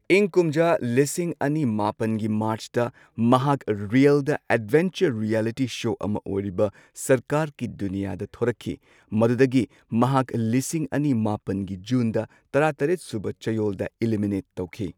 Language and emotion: Manipuri, neutral